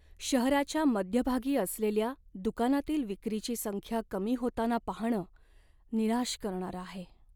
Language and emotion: Marathi, sad